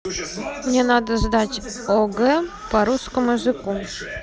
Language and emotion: Russian, neutral